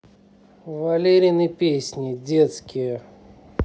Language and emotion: Russian, neutral